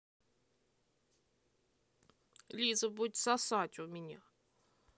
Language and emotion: Russian, angry